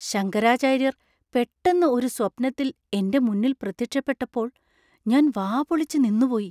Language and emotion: Malayalam, surprised